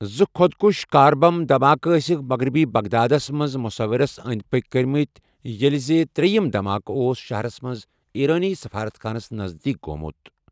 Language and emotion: Kashmiri, neutral